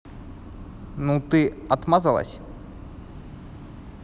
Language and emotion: Russian, neutral